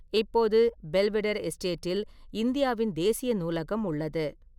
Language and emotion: Tamil, neutral